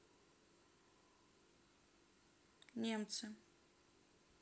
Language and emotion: Russian, neutral